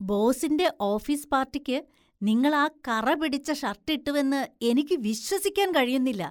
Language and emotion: Malayalam, disgusted